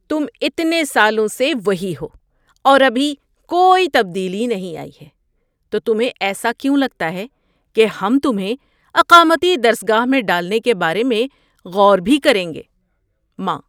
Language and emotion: Urdu, surprised